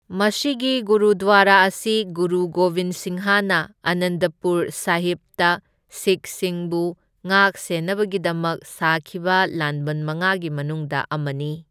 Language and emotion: Manipuri, neutral